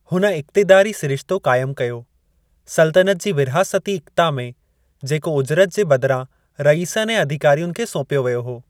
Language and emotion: Sindhi, neutral